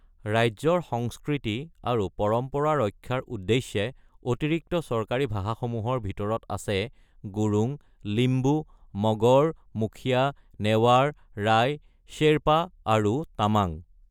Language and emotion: Assamese, neutral